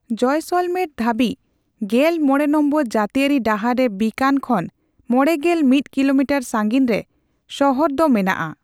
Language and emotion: Santali, neutral